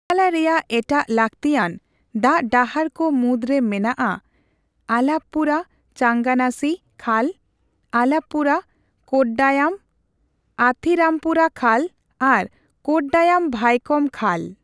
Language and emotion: Santali, neutral